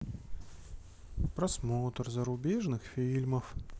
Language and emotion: Russian, sad